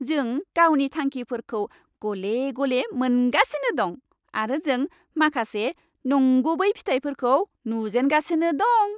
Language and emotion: Bodo, happy